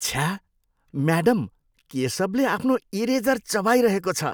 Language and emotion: Nepali, disgusted